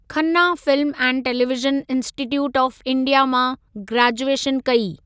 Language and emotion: Sindhi, neutral